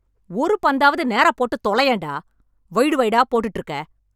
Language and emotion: Tamil, angry